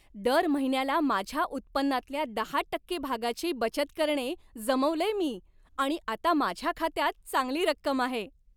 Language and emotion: Marathi, happy